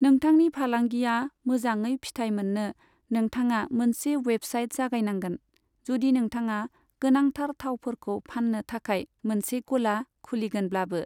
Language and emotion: Bodo, neutral